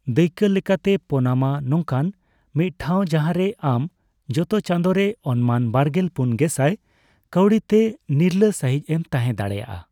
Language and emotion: Santali, neutral